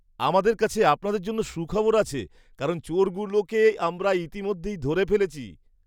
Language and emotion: Bengali, happy